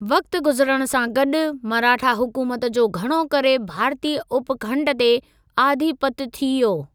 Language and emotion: Sindhi, neutral